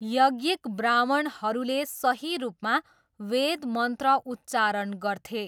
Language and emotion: Nepali, neutral